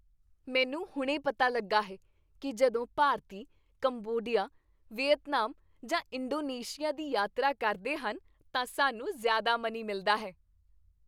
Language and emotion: Punjabi, happy